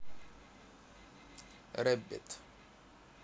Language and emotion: Russian, neutral